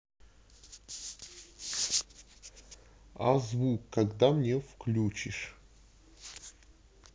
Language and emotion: Russian, neutral